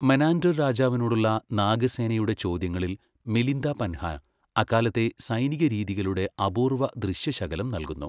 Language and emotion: Malayalam, neutral